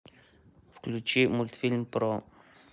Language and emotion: Russian, neutral